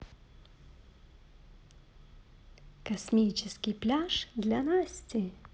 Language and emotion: Russian, positive